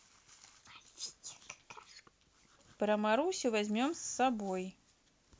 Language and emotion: Russian, neutral